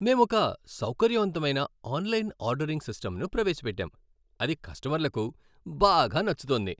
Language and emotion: Telugu, happy